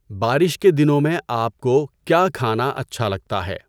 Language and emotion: Urdu, neutral